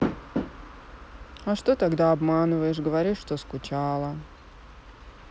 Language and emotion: Russian, sad